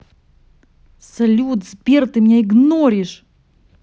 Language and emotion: Russian, angry